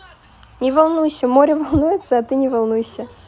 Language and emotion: Russian, positive